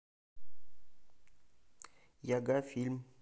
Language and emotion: Russian, neutral